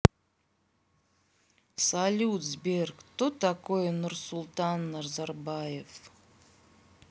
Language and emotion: Russian, neutral